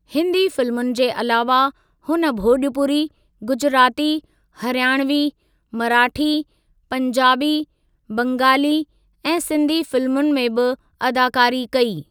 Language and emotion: Sindhi, neutral